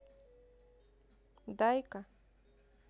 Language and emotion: Russian, neutral